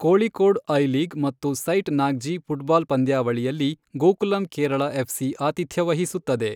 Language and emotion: Kannada, neutral